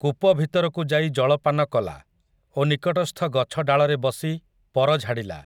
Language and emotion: Odia, neutral